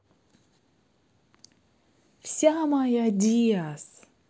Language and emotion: Russian, positive